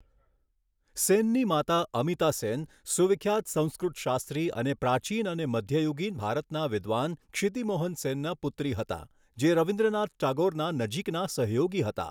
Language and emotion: Gujarati, neutral